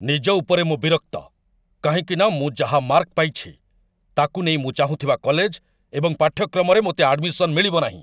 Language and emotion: Odia, angry